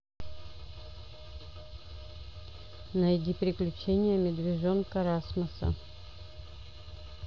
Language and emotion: Russian, neutral